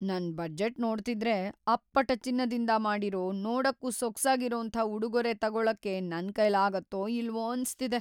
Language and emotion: Kannada, fearful